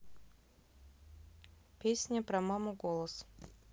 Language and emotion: Russian, neutral